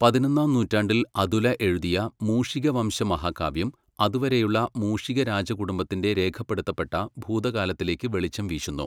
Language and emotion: Malayalam, neutral